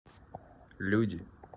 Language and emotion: Russian, neutral